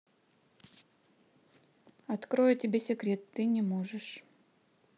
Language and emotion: Russian, neutral